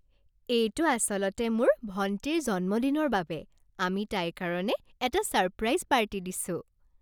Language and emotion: Assamese, happy